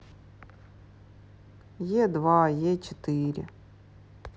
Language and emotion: Russian, sad